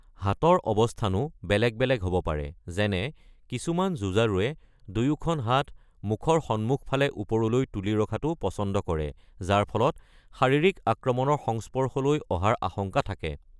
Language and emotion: Assamese, neutral